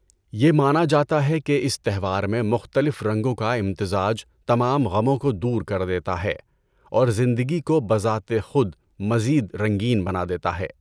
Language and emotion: Urdu, neutral